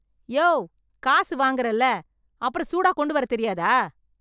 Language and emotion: Tamil, angry